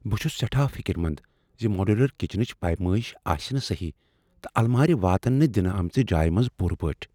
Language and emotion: Kashmiri, fearful